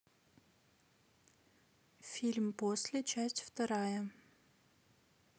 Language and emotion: Russian, neutral